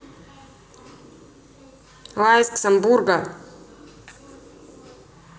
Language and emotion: Russian, neutral